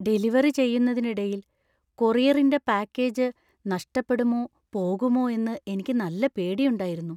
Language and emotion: Malayalam, fearful